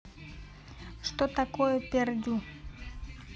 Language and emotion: Russian, neutral